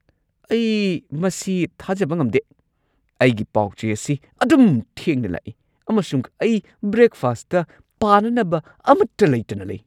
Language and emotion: Manipuri, angry